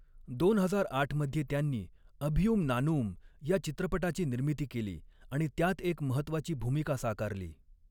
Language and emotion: Marathi, neutral